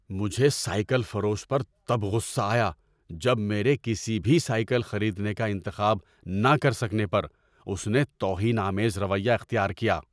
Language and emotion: Urdu, angry